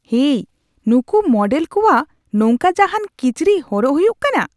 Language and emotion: Santali, disgusted